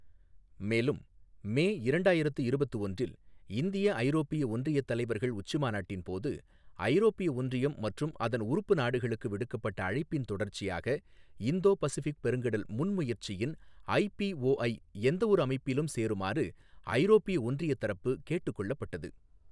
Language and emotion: Tamil, neutral